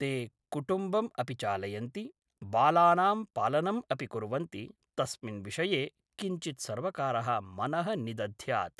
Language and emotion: Sanskrit, neutral